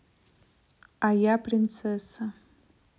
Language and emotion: Russian, neutral